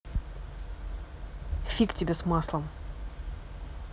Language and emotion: Russian, angry